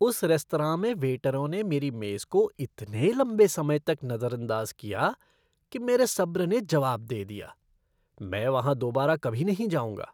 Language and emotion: Hindi, disgusted